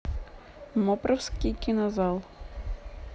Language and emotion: Russian, neutral